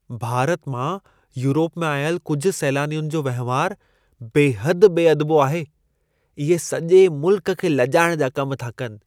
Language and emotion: Sindhi, disgusted